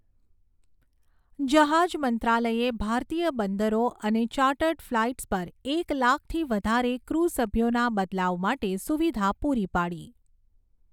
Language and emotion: Gujarati, neutral